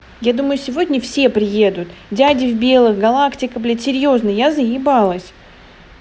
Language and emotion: Russian, angry